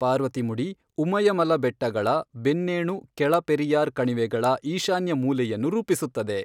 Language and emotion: Kannada, neutral